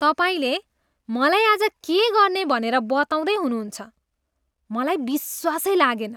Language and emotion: Nepali, disgusted